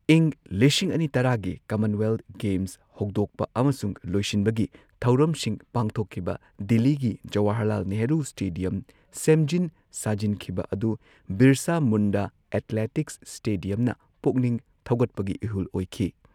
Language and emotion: Manipuri, neutral